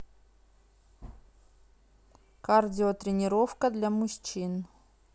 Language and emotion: Russian, neutral